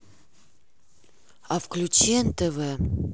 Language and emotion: Russian, neutral